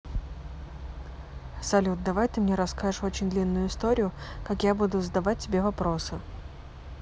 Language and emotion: Russian, neutral